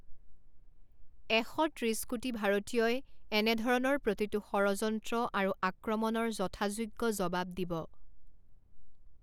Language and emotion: Assamese, neutral